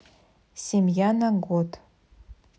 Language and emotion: Russian, neutral